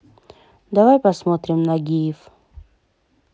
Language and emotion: Russian, neutral